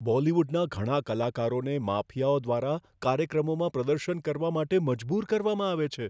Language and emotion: Gujarati, fearful